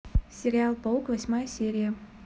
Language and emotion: Russian, positive